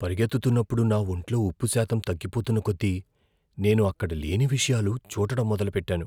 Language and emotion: Telugu, fearful